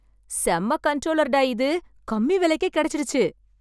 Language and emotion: Tamil, happy